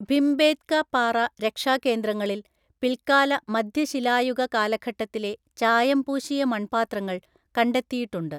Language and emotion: Malayalam, neutral